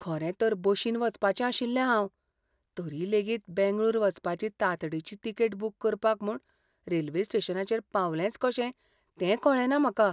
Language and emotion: Goan Konkani, fearful